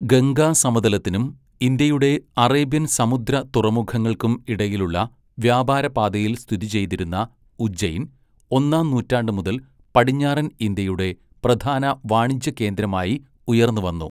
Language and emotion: Malayalam, neutral